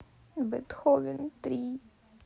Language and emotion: Russian, sad